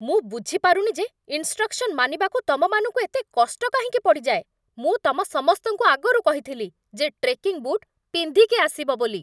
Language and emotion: Odia, angry